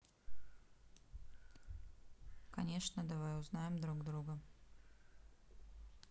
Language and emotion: Russian, neutral